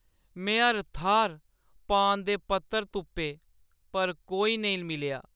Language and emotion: Dogri, sad